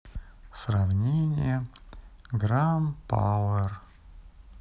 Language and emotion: Russian, sad